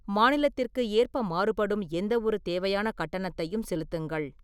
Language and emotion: Tamil, neutral